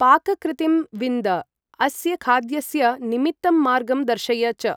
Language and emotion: Sanskrit, neutral